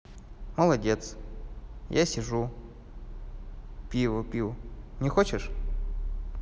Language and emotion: Russian, positive